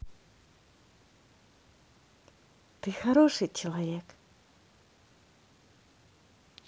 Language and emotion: Russian, positive